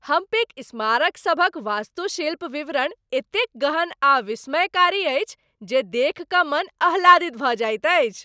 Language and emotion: Maithili, happy